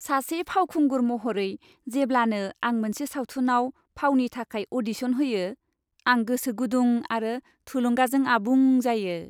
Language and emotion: Bodo, happy